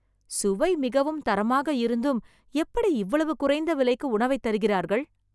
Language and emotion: Tamil, surprised